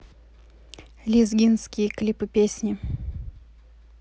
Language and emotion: Russian, neutral